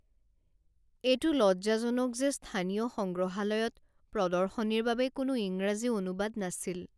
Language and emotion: Assamese, sad